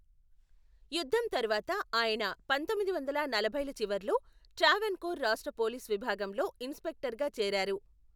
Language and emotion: Telugu, neutral